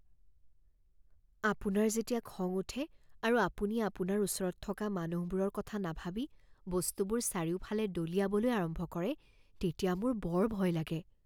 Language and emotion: Assamese, fearful